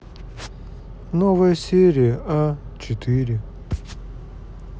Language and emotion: Russian, sad